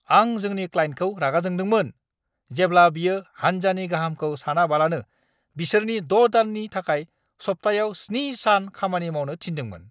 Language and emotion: Bodo, angry